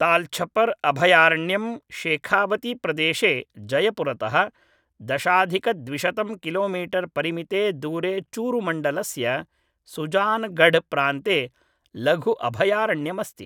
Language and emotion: Sanskrit, neutral